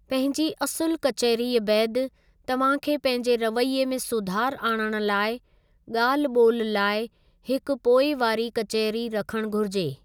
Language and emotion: Sindhi, neutral